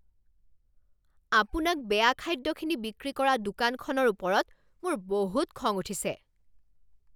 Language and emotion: Assamese, angry